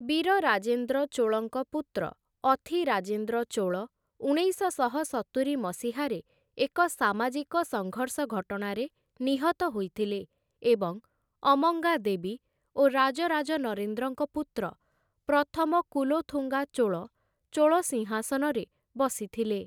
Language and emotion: Odia, neutral